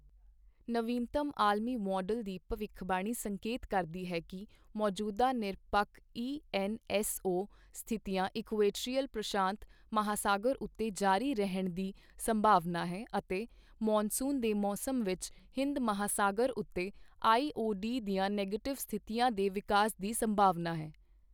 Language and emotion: Punjabi, neutral